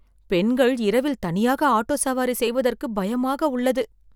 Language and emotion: Tamil, fearful